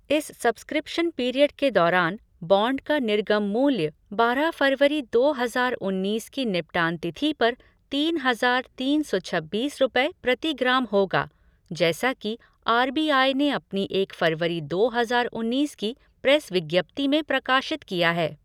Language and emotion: Hindi, neutral